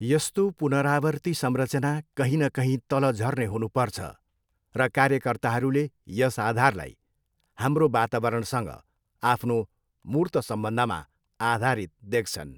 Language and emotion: Nepali, neutral